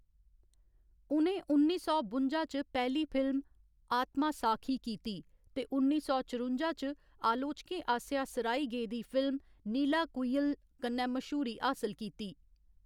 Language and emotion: Dogri, neutral